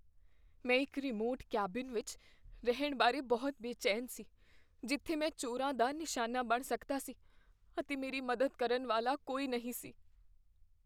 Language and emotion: Punjabi, fearful